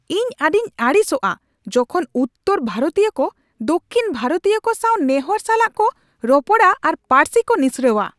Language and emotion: Santali, angry